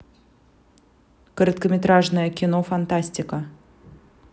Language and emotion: Russian, neutral